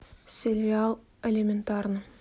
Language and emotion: Russian, neutral